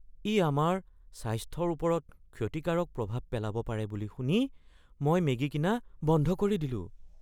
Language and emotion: Assamese, fearful